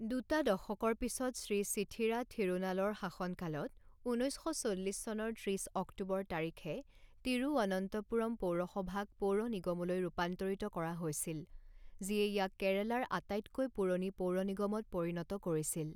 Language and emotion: Assamese, neutral